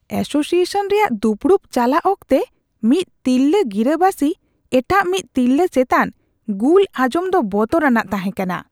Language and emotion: Santali, disgusted